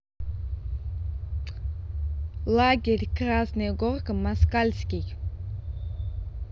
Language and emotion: Russian, neutral